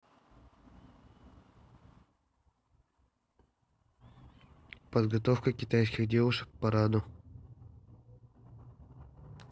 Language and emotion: Russian, neutral